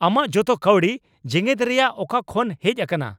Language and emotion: Santali, angry